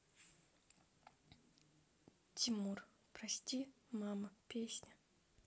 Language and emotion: Russian, sad